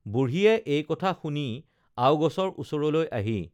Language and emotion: Assamese, neutral